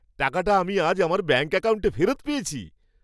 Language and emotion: Bengali, happy